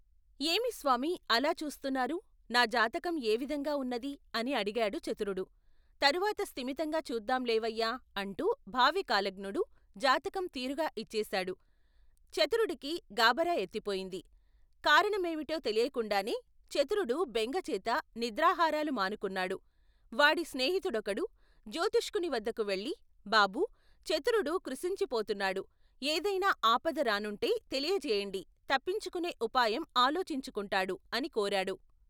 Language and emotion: Telugu, neutral